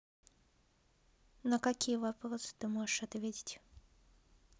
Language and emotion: Russian, neutral